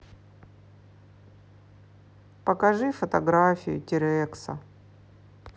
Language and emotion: Russian, sad